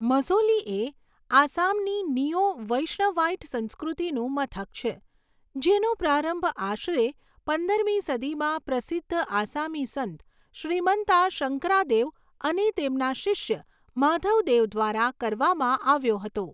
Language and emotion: Gujarati, neutral